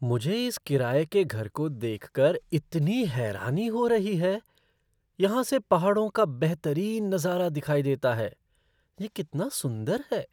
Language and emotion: Hindi, surprised